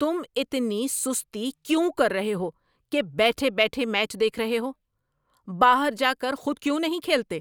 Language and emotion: Urdu, angry